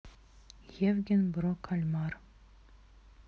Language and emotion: Russian, neutral